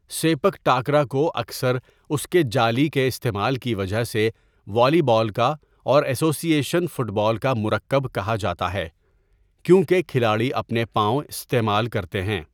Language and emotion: Urdu, neutral